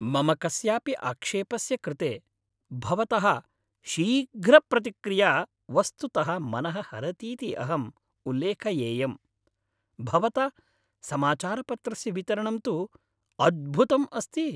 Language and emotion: Sanskrit, happy